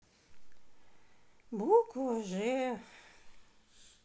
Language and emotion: Russian, sad